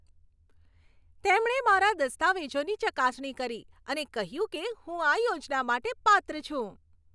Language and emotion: Gujarati, happy